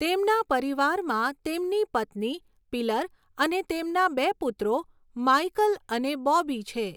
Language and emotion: Gujarati, neutral